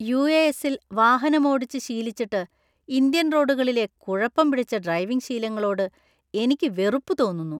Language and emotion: Malayalam, disgusted